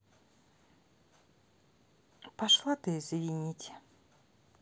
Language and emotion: Russian, angry